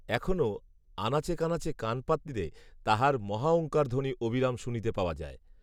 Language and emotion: Bengali, neutral